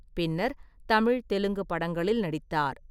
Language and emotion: Tamil, neutral